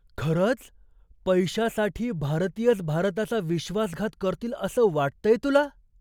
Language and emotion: Marathi, surprised